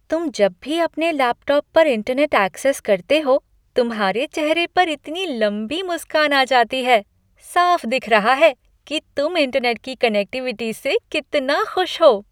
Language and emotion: Hindi, happy